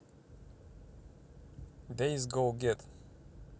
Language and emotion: Russian, neutral